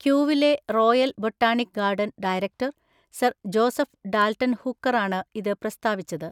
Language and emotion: Malayalam, neutral